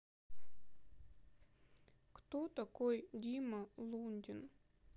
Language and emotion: Russian, sad